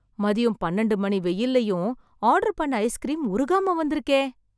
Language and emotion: Tamil, surprised